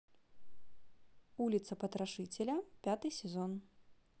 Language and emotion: Russian, neutral